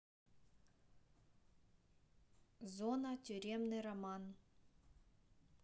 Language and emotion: Russian, neutral